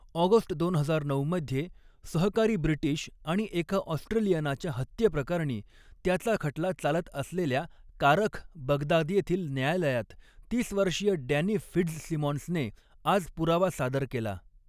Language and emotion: Marathi, neutral